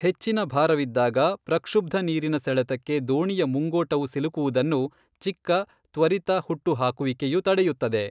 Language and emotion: Kannada, neutral